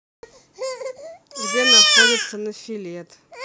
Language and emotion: Russian, neutral